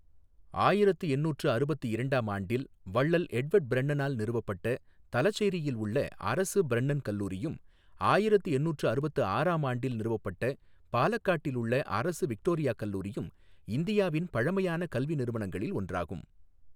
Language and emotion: Tamil, neutral